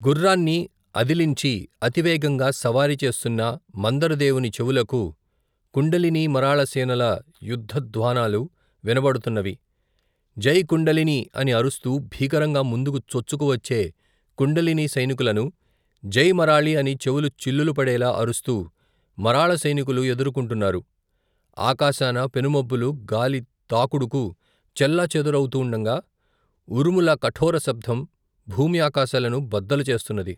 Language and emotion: Telugu, neutral